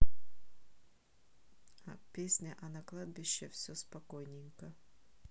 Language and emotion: Russian, neutral